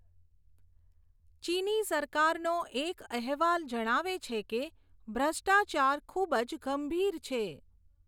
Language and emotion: Gujarati, neutral